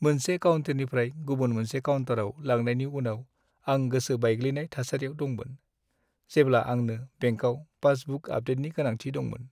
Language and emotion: Bodo, sad